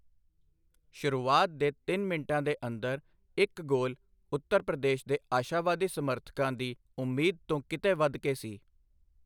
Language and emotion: Punjabi, neutral